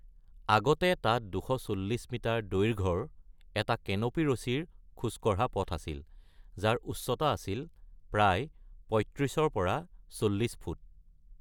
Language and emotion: Assamese, neutral